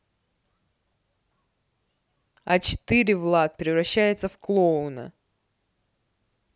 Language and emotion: Russian, neutral